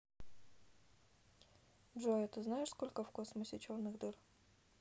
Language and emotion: Russian, neutral